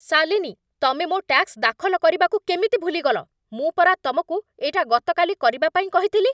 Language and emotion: Odia, angry